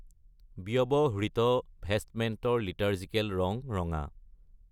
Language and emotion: Assamese, neutral